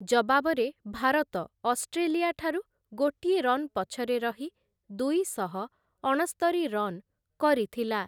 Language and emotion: Odia, neutral